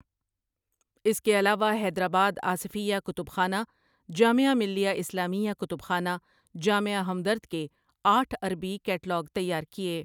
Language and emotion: Urdu, neutral